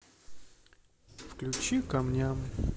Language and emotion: Russian, sad